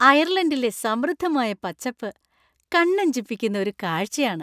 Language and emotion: Malayalam, happy